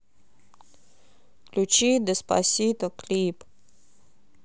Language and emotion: Russian, neutral